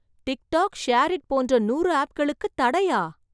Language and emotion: Tamil, surprised